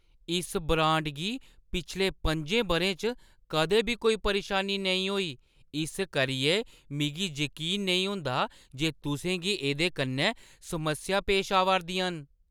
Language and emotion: Dogri, surprised